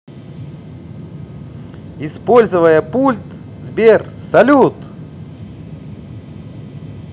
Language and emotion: Russian, positive